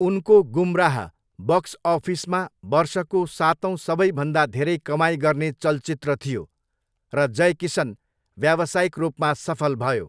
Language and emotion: Nepali, neutral